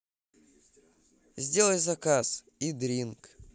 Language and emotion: Russian, neutral